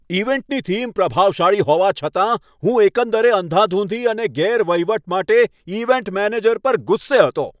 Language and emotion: Gujarati, angry